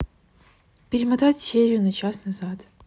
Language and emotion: Russian, neutral